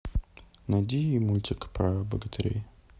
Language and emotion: Russian, neutral